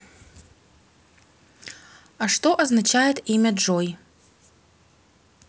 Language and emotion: Russian, neutral